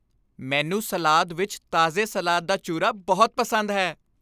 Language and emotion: Punjabi, happy